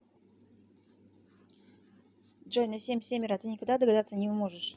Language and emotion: Russian, neutral